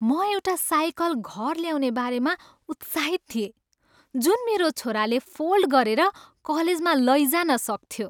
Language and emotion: Nepali, happy